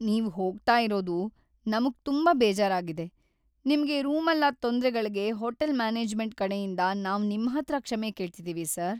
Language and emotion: Kannada, sad